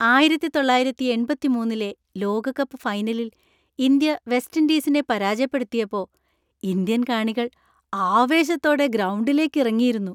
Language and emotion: Malayalam, happy